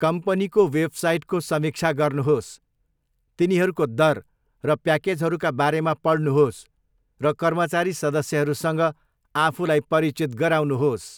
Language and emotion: Nepali, neutral